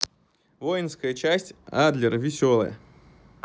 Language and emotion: Russian, neutral